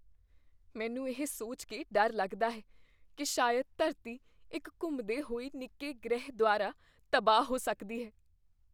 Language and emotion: Punjabi, fearful